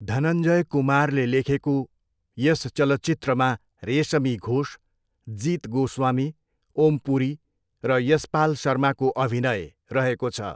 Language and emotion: Nepali, neutral